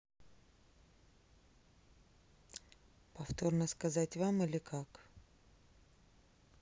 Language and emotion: Russian, neutral